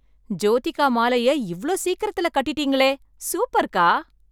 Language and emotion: Tamil, surprised